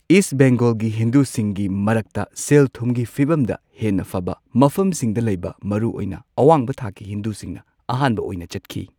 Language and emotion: Manipuri, neutral